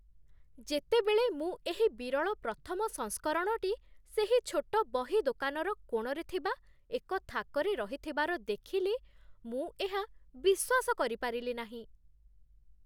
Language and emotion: Odia, surprised